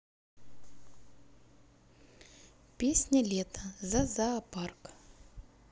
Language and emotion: Russian, neutral